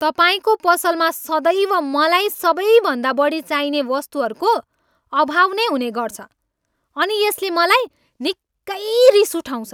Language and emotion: Nepali, angry